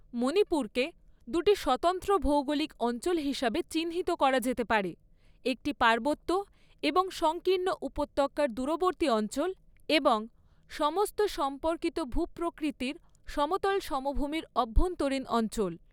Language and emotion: Bengali, neutral